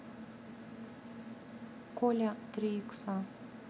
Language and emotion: Russian, neutral